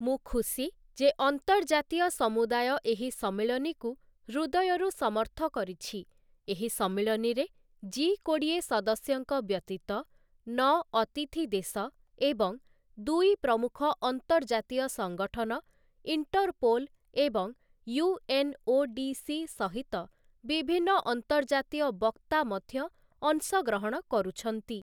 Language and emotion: Odia, neutral